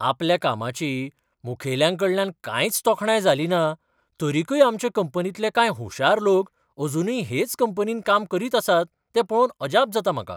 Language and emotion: Goan Konkani, surprised